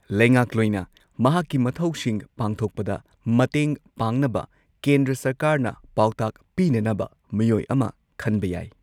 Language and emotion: Manipuri, neutral